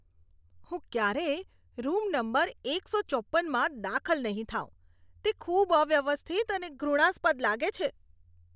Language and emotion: Gujarati, disgusted